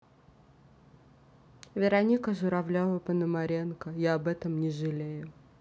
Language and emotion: Russian, neutral